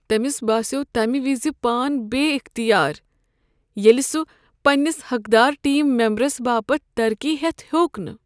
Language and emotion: Kashmiri, sad